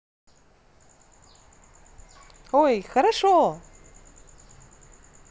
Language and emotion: Russian, positive